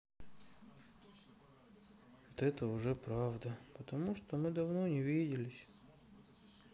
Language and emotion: Russian, sad